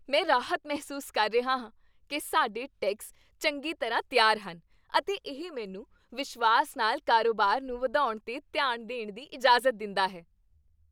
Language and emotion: Punjabi, happy